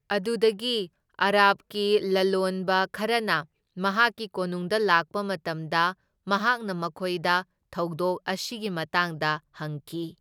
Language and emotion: Manipuri, neutral